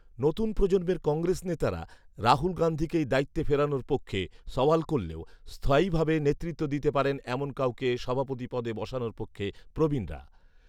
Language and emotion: Bengali, neutral